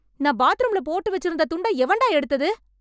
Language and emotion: Tamil, angry